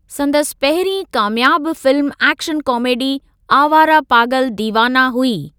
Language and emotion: Sindhi, neutral